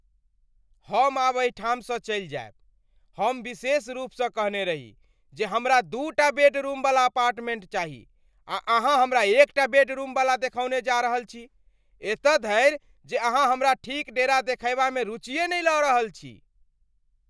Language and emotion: Maithili, angry